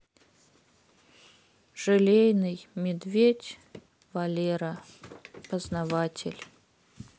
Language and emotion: Russian, sad